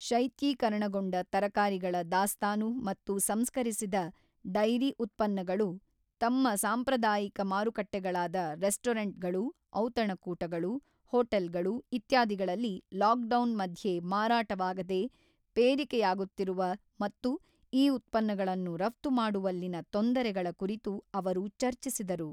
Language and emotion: Kannada, neutral